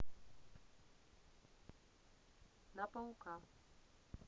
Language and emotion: Russian, neutral